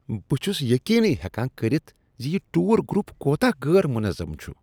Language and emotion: Kashmiri, disgusted